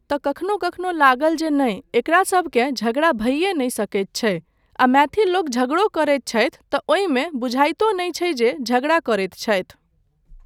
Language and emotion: Maithili, neutral